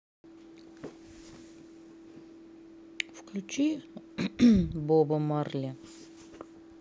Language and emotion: Russian, neutral